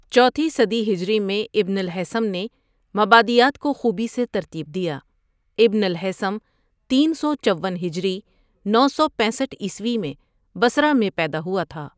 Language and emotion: Urdu, neutral